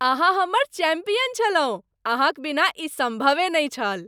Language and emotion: Maithili, happy